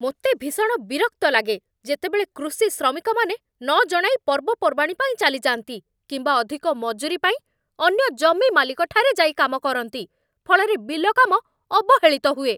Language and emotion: Odia, angry